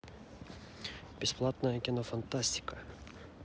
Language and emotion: Russian, neutral